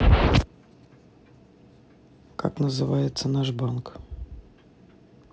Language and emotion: Russian, neutral